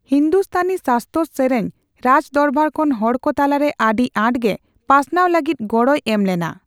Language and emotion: Santali, neutral